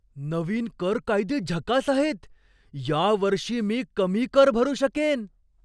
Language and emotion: Marathi, surprised